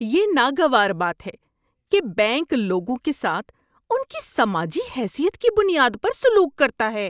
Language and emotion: Urdu, disgusted